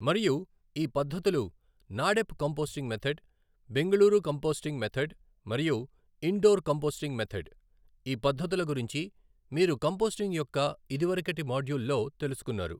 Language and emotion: Telugu, neutral